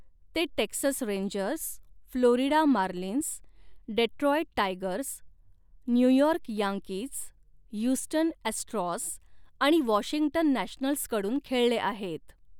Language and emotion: Marathi, neutral